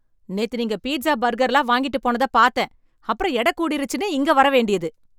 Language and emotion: Tamil, angry